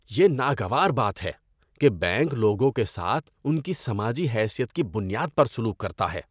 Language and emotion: Urdu, disgusted